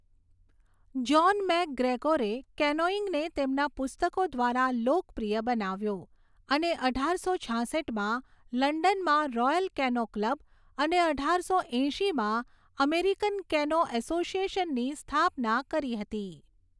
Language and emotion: Gujarati, neutral